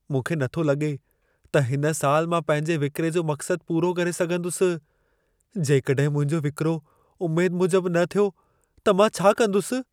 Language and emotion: Sindhi, fearful